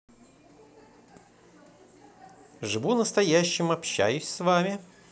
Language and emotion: Russian, positive